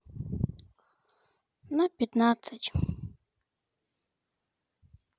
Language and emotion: Russian, sad